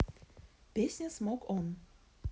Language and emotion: Russian, neutral